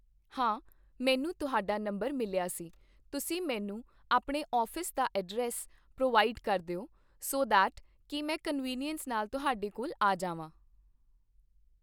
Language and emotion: Punjabi, neutral